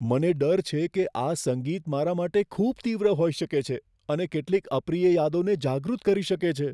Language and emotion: Gujarati, fearful